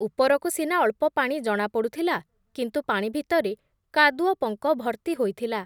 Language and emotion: Odia, neutral